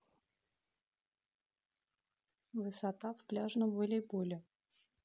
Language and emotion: Russian, neutral